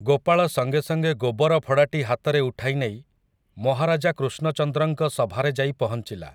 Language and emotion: Odia, neutral